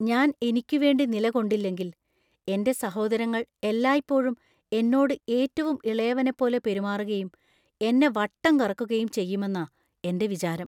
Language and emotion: Malayalam, fearful